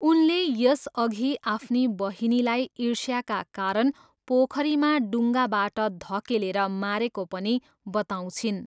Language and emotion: Nepali, neutral